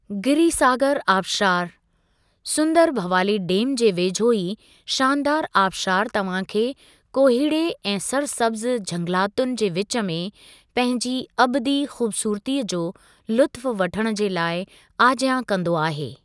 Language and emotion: Sindhi, neutral